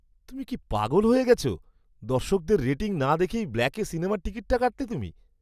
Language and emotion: Bengali, surprised